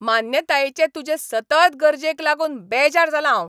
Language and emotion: Goan Konkani, angry